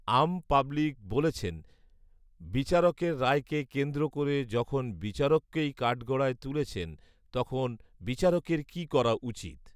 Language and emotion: Bengali, neutral